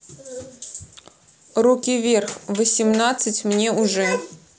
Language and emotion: Russian, neutral